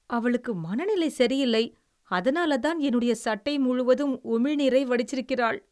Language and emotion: Tamil, disgusted